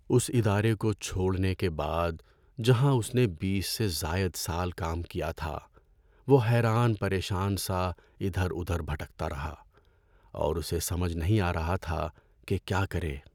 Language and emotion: Urdu, sad